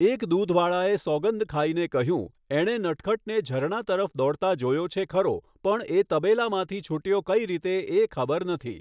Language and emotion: Gujarati, neutral